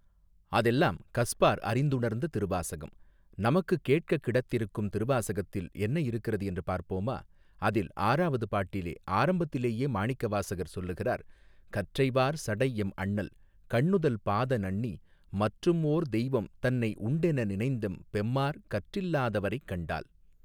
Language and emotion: Tamil, neutral